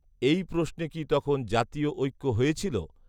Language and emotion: Bengali, neutral